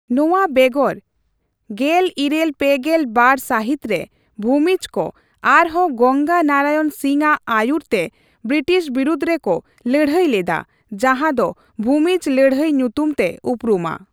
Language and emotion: Santali, neutral